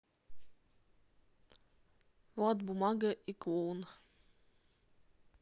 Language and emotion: Russian, neutral